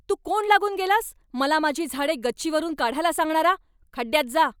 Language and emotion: Marathi, angry